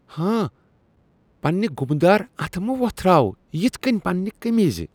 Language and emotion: Kashmiri, disgusted